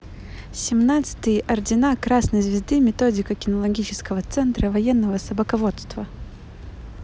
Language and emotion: Russian, positive